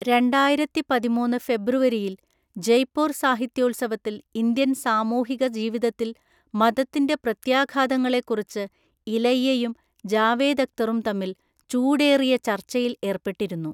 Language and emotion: Malayalam, neutral